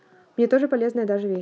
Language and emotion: Russian, neutral